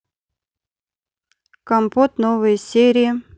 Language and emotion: Russian, neutral